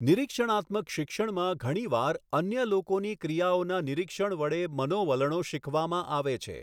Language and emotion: Gujarati, neutral